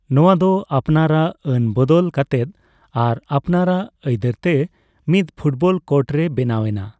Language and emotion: Santali, neutral